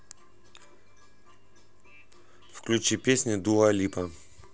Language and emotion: Russian, neutral